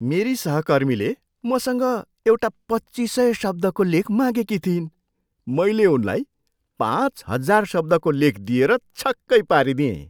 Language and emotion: Nepali, surprised